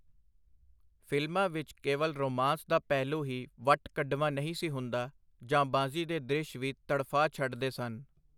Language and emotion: Punjabi, neutral